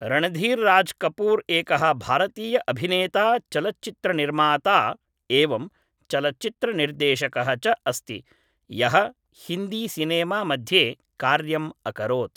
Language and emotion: Sanskrit, neutral